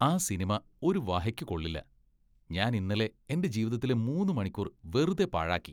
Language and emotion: Malayalam, disgusted